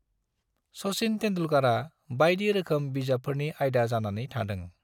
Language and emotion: Bodo, neutral